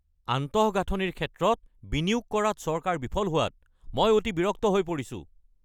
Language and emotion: Assamese, angry